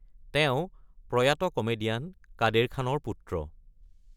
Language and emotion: Assamese, neutral